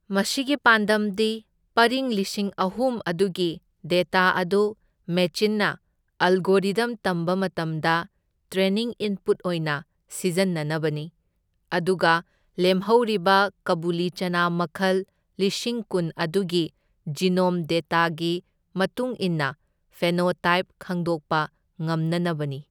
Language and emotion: Manipuri, neutral